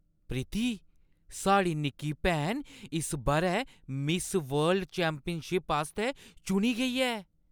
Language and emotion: Dogri, surprised